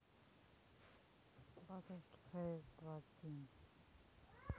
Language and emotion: Russian, neutral